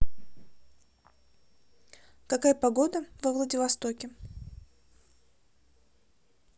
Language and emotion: Russian, neutral